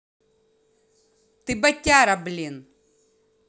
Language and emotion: Russian, angry